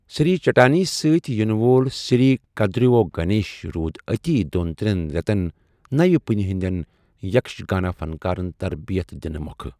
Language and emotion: Kashmiri, neutral